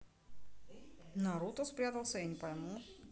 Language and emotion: Russian, neutral